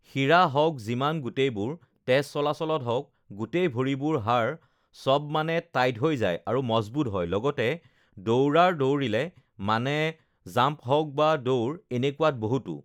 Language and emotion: Assamese, neutral